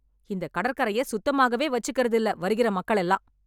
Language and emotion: Tamil, angry